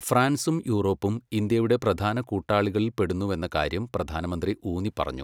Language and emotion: Malayalam, neutral